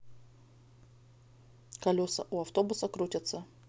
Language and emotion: Russian, neutral